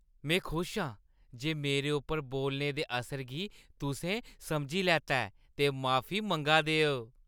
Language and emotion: Dogri, happy